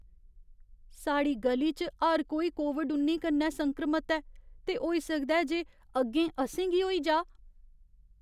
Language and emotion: Dogri, fearful